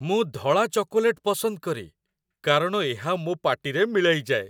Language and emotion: Odia, happy